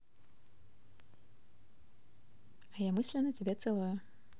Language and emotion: Russian, positive